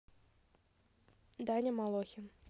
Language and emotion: Russian, neutral